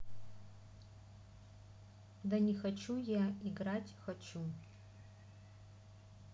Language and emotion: Russian, neutral